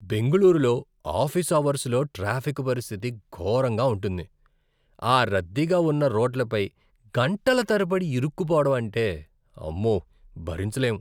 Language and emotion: Telugu, disgusted